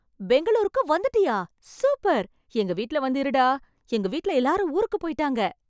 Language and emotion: Tamil, happy